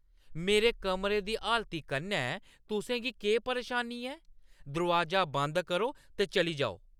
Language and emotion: Dogri, angry